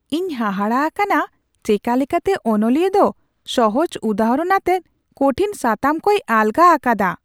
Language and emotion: Santali, surprised